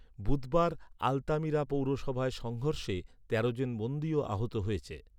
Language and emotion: Bengali, neutral